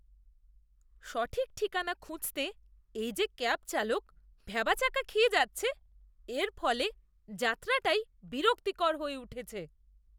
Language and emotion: Bengali, disgusted